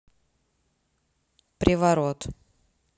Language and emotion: Russian, neutral